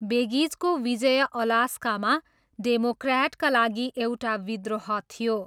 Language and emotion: Nepali, neutral